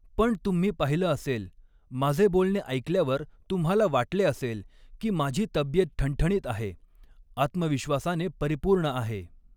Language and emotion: Marathi, neutral